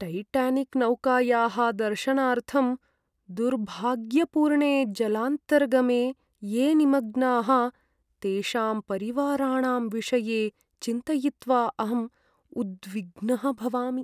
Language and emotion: Sanskrit, sad